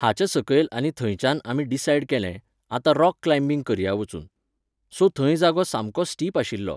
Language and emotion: Goan Konkani, neutral